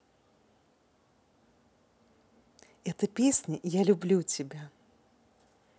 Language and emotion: Russian, positive